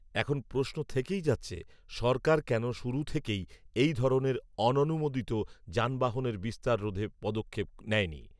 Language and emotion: Bengali, neutral